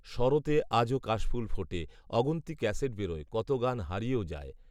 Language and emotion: Bengali, neutral